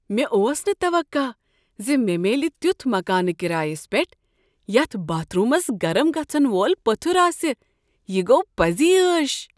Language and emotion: Kashmiri, surprised